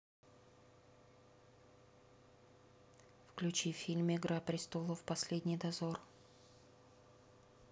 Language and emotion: Russian, neutral